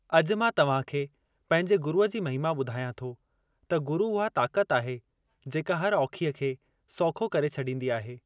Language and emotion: Sindhi, neutral